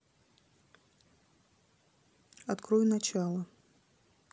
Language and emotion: Russian, neutral